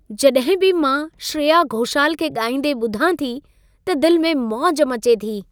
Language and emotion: Sindhi, happy